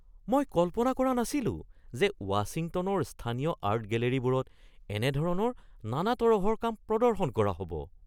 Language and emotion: Assamese, surprised